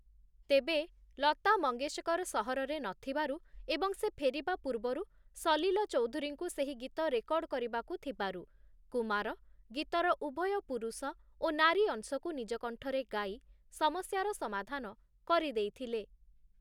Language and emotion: Odia, neutral